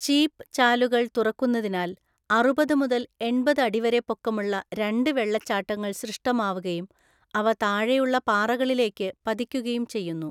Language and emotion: Malayalam, neutral